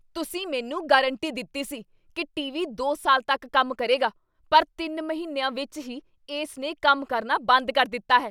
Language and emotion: Punjabi, angry